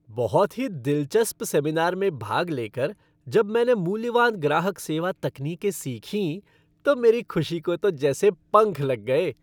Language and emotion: Hindi, happy